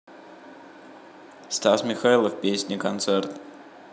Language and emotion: Russian, neutral